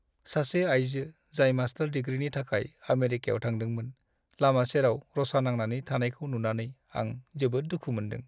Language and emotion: Bodo, sad